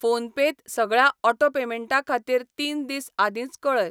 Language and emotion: Goan Konkani, neutral